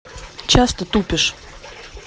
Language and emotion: Russian, angry